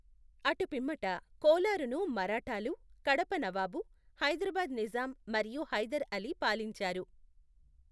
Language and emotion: Telugu, neutral